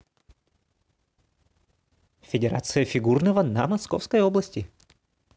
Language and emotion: Russian, positive